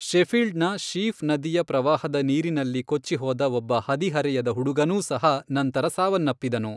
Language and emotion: Kannada, neutral